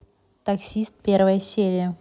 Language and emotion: Russian, neutral